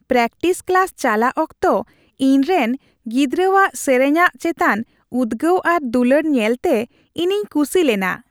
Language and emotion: Santali, happy